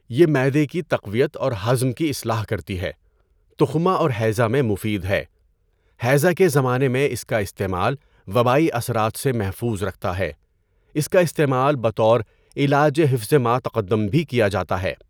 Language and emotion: Urdu, neutral